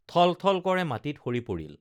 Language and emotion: Assamese, neutral